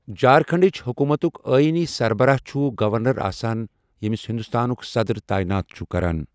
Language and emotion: Kashmiri, neutral